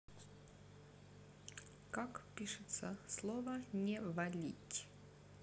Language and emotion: Russian, neutral